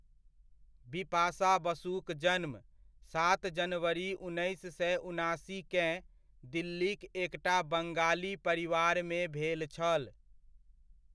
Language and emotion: Maithili, neutral